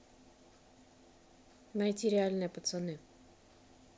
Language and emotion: Russian, neutral